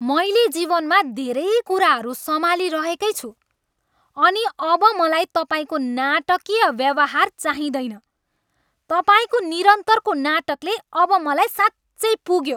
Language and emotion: Nepali, angry